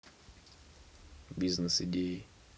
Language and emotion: Russian, neutral